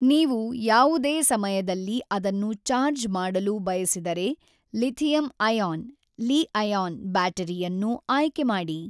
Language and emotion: Kannada, neutral